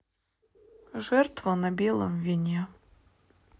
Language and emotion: Russian, sad